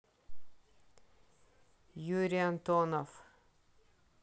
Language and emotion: Russian, neutral